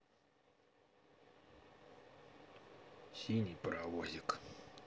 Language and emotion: Russian, neutral